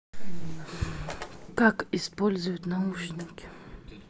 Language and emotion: Russian, sad